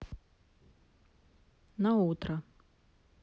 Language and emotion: Russian, neutral